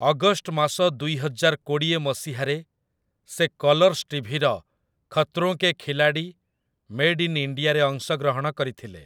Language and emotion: Odia, neutral